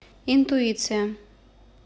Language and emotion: Russian, neutral